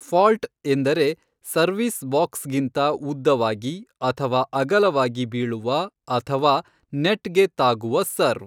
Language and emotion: Kannada, neutral